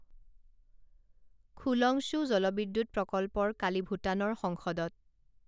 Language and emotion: Assamese, neutral